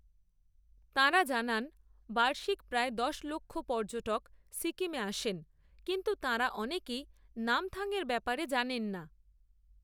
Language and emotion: Bengali, neutral